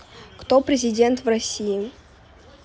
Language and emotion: Russian, neutral